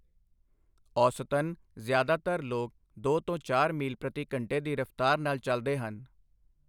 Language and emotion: Punjabi, neutral